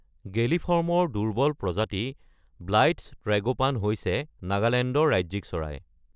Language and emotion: Assamese, neutral